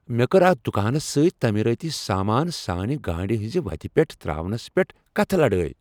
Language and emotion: Kashmiri, angry